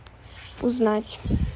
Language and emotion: Russian, neutral